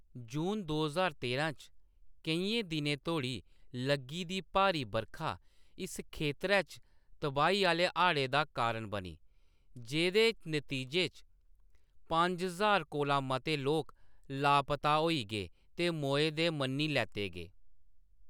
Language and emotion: Dogri, neutral